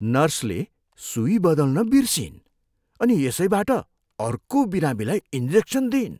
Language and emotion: Nepali, disgusted